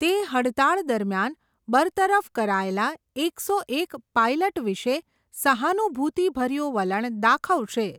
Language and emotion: Gujarati, neutral